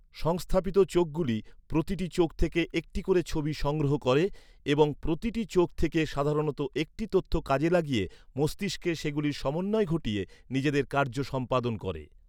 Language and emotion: Bengali, neutral